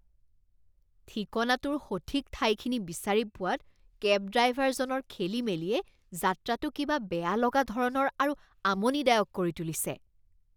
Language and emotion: Assamese, disgusted